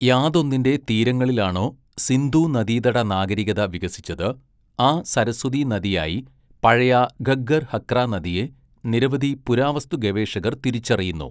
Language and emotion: Malayalam, neutral